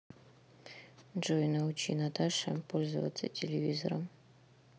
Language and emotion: Russian, neutral